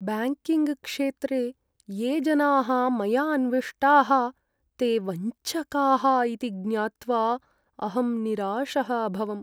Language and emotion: Sanskrit, sad